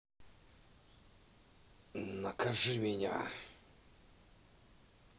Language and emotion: Russian, angry